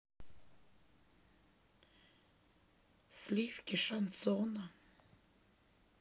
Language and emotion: Russian, sad